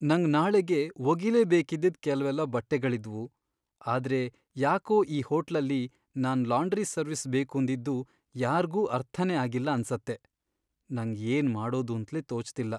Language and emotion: Kannada, sad